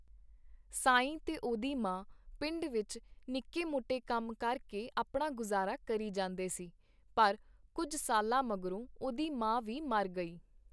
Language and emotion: Punjabi, neutral